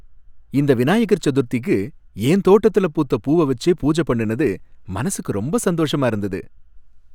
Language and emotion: Tamil, happy